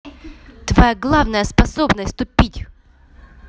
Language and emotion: Russian, angry